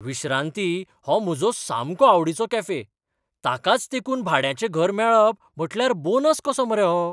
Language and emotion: Goan Konkani, surprised